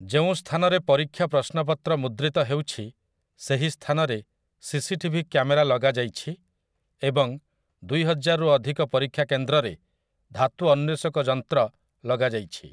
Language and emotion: Odia, neutral